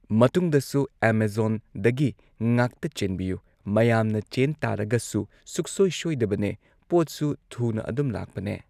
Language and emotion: Manipuri, neutral